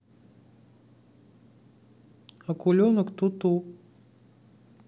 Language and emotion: Russian, neutral